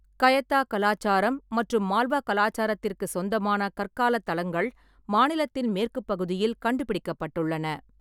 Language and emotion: Tamil, neutral